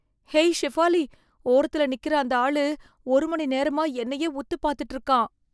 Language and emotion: Tamil, fearful